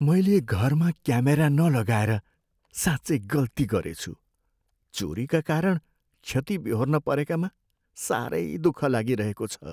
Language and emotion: Nepali, sad